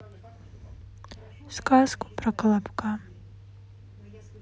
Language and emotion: Russian, sad